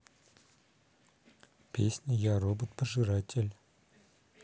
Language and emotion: Russian, neutral